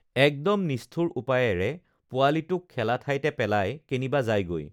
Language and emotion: Assamese, neutral